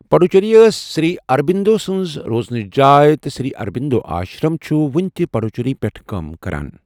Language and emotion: Kashmiri, neutral